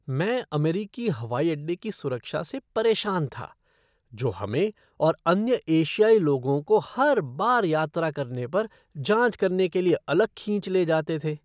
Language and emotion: Hindi, disgusted